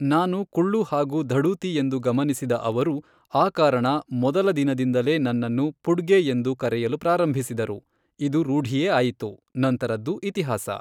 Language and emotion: Kannada, neutral